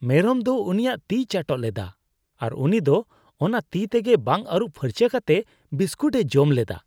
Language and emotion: Santali, disgusted